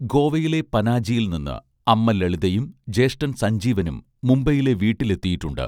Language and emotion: Malayalam, neutral